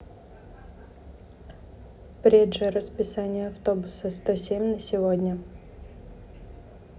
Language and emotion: Russian, neutral